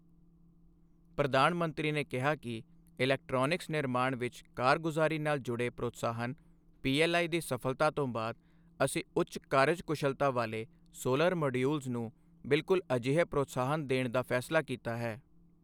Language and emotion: Punjabi, neutral